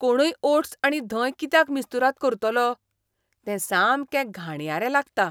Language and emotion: Goan Konkani, disgusted